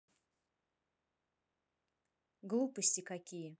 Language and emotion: Russian, neutral